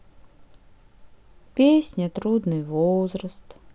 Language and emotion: Russian, sad